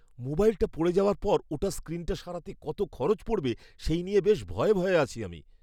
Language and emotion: Bengali, fearful